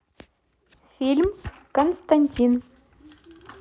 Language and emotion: Russian, neutral